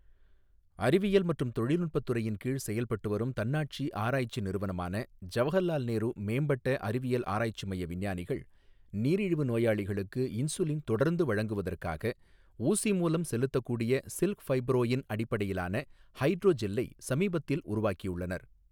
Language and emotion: Tamil, neutral